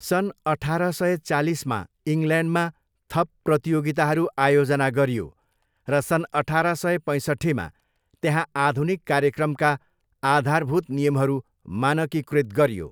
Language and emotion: Nepali, neutral